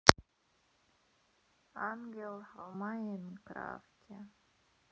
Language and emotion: Russian, sad